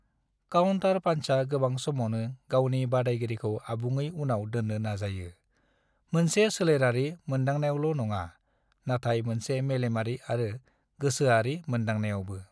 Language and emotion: Bodo, neutral